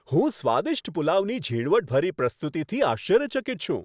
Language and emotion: Gujarati, happy